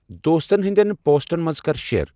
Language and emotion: Kashmiri, neutral